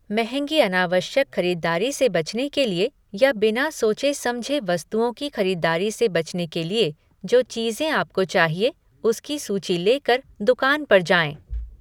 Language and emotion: Hindi, neutral